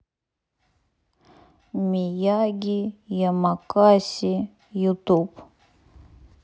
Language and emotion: Russian, neutral